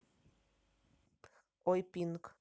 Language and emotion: Russian, neutral